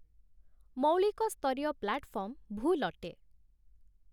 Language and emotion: Odia, neutral